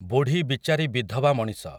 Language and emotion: Odia, neutral